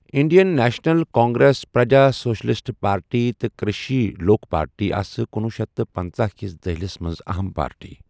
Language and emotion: Kashmiri, neutral